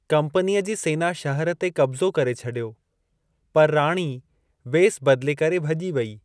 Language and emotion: Sindhi, neutral